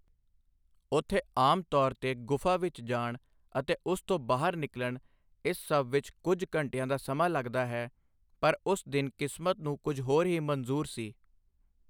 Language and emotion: Punjabi, neutral